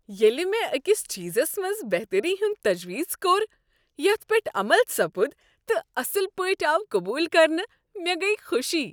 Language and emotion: Kashmiri, happy